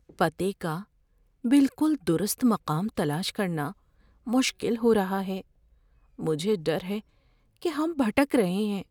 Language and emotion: Urdu, fearful